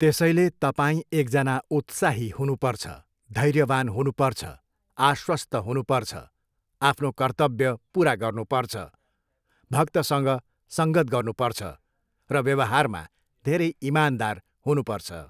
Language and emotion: Nepali, neutral